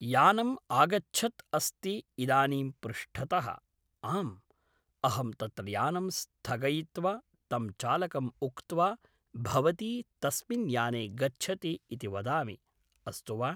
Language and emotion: Sanskrit, neutral